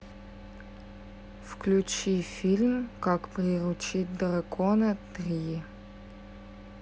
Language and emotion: Russian, neutral